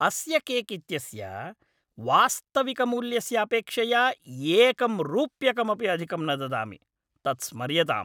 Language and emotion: Sanskrit, angry